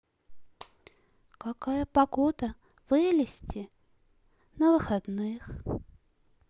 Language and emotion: Russian, sad